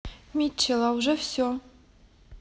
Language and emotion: Russian, neutral